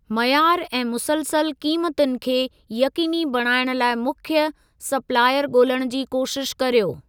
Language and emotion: Sindhi, neutral